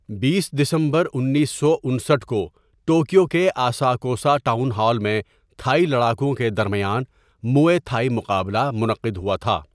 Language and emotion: Urdu, neutral